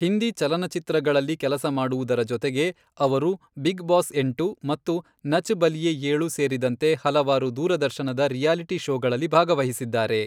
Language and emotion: Kannada, neutral